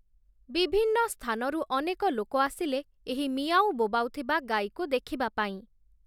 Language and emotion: Odia, neutral